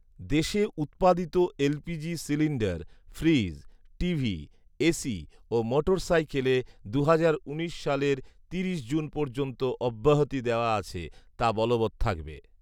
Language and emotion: Bengali, neutral